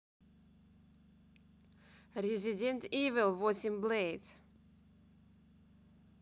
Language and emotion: Russian, neutral